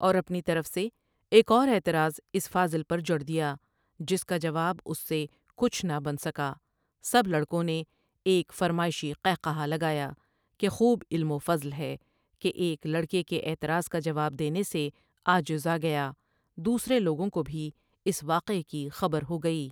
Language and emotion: Urdu, neutral